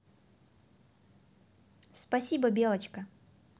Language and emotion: Russian, positive